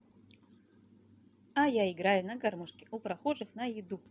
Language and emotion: Russian, positive